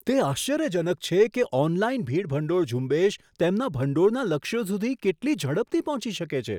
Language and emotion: Gujarati, surprised